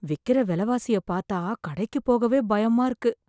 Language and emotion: Tamil, fearful